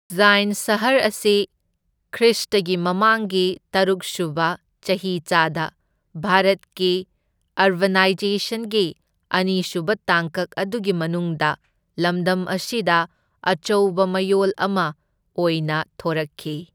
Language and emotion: Manipuri, neutral